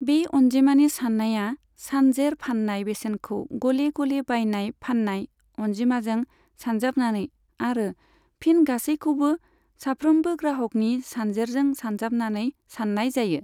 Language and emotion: Bodo, neutral